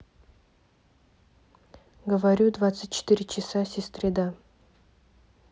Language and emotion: Russian, neutral